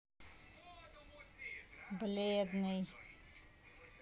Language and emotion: Russian, neutral